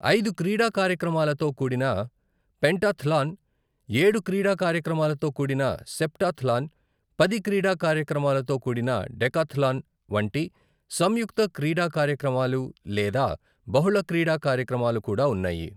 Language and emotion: Telugu, neutral